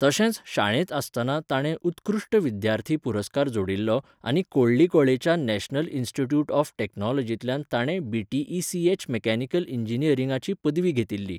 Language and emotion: Goan Konkani, neutral